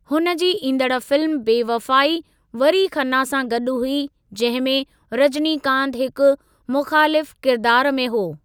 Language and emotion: Sindhi, neutral